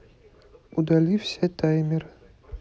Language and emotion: Russian, neutral